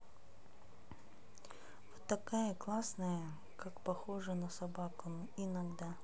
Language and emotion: Russian, sad